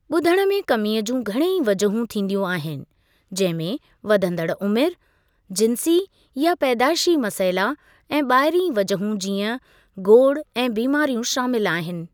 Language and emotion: Sindhi, neutral